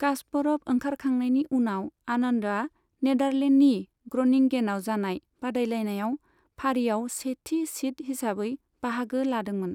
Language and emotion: Bodo, neutral